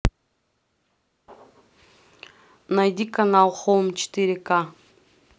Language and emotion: Russian, neutral